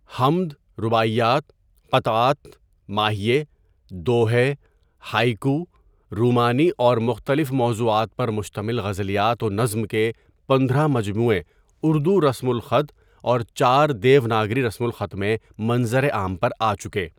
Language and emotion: Urdu, neutral